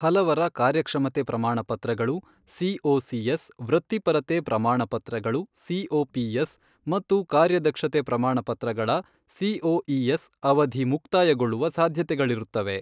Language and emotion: Kannada, neutral